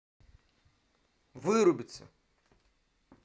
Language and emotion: Russian, angry